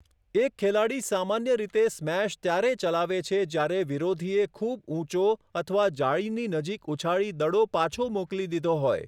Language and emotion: Gujarati, neutral